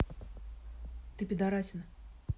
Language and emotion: Russian, neutral